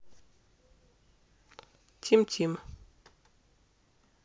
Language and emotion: Russian, neutral